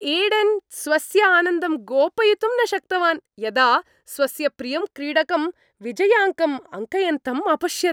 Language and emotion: Sanskrit, happy